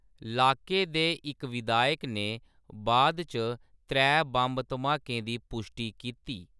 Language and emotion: Dogri, neutral